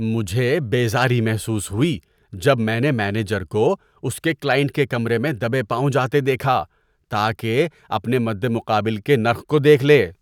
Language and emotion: Urdu, disgusted